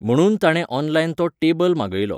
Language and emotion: Goan Konkani, neutral